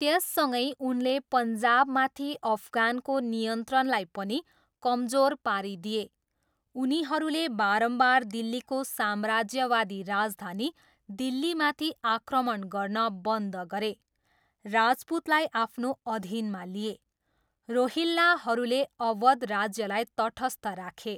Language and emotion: Nepali, neutral